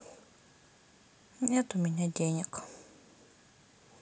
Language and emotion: Russian, sad